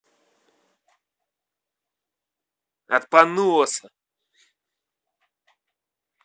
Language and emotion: Russian, angry